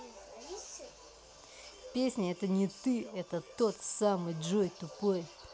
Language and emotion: Russian, angry